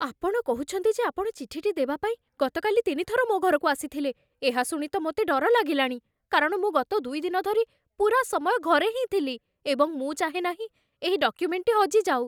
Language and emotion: Odia, fearful